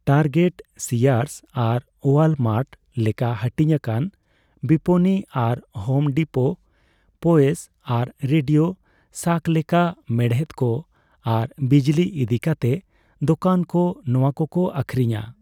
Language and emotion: Santali, neutral